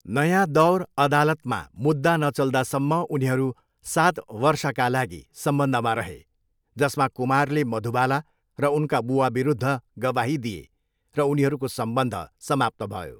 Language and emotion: Nepali, neutral